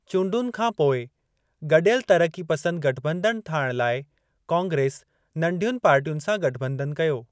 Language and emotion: Sindhi, neutral